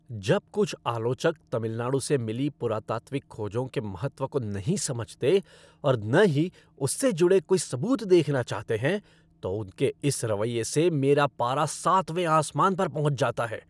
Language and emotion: Hindi, angry